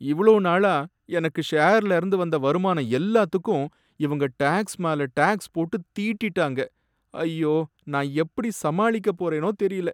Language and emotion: Tamil, sad